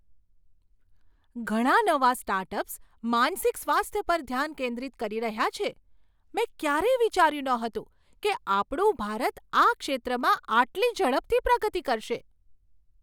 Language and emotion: Gujarati, surprised